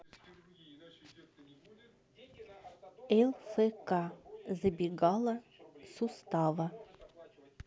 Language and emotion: Russian, neutral